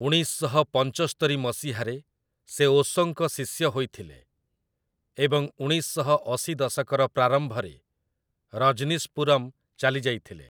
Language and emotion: Odia, neutral